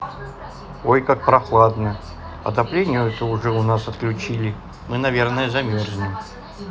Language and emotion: Russian, neutral